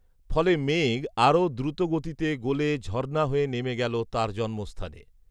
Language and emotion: Bengali, neutral